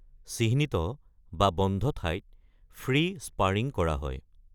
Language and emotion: Assamese, neutral